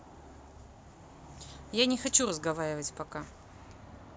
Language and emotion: Russian, neutral